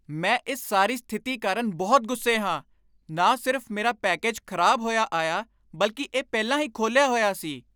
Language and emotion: Punjabi, angry